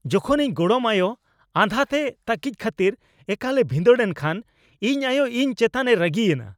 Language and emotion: Santali, angry